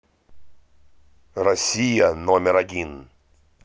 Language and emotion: Russian, positive